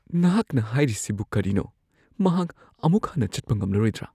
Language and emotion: Manipuri, fearful